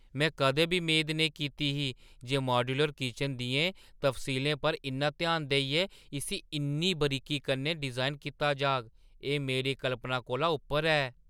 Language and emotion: Dogri, surprised